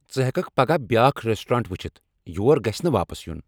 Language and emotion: Kashmiri, angry